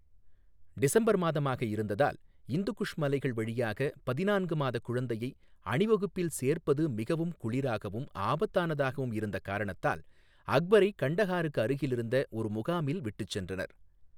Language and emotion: Tamil, neutral